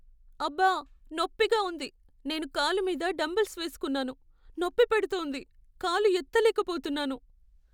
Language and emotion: Telugu, sad